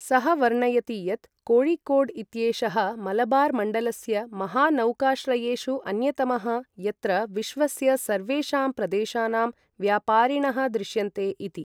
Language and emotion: Sanskrit, neutral